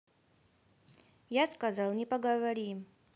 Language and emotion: Russian, neutral